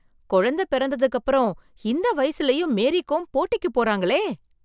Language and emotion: Tamil, surprised